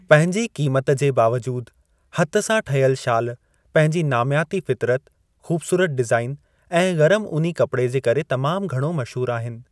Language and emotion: Sindhi, neutral